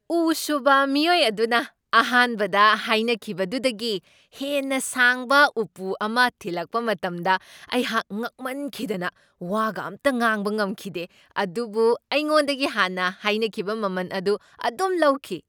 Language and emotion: Manipuri, surprised